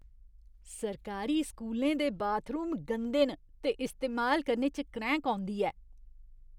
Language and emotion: Dogri, disgusted